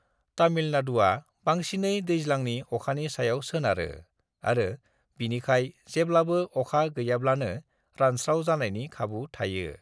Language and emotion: Bodo, neutral